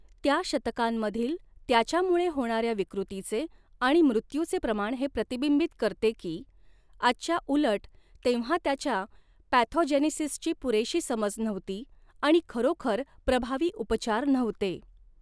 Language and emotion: Marathi, neutral